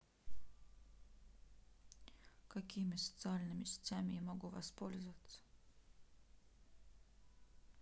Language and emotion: Russian, neutral